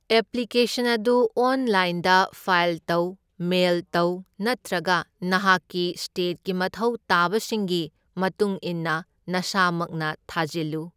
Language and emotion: Manipuri, neutral